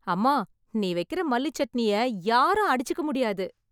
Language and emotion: Tamil, happy